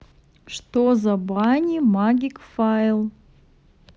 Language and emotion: Russian, neutral